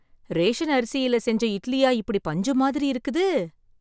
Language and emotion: Tamil, surprised